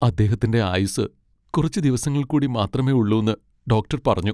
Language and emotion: Malayalam, sad